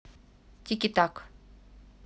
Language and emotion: Russian, neutral